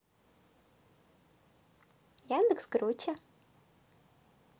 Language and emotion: Russian, positive